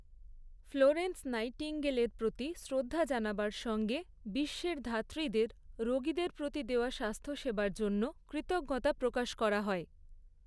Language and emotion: Bengali, neutral